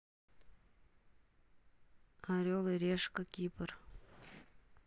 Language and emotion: Russian, neutral